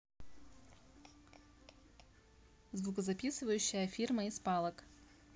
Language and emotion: Russian, neutral